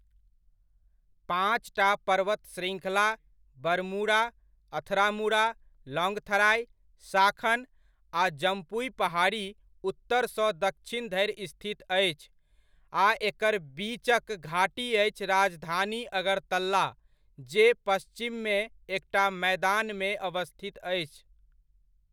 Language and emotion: Maithili, neutral